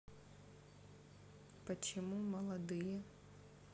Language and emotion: Russian, sad